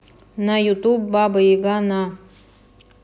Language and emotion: Russian, neutral